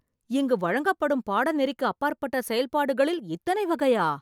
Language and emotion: Tamil, surprised